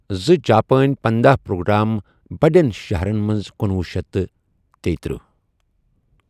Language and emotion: Kashmiri, neutral